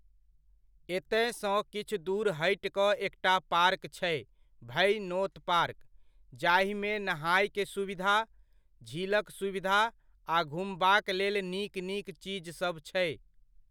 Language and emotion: Maithili, neutral